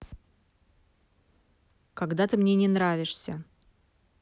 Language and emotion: Russian, neutral